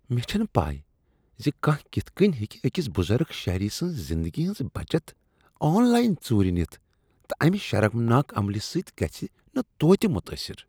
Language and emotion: Kashmiri, disgusted